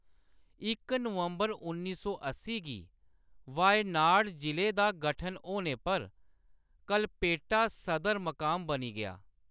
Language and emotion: Dogri, neutral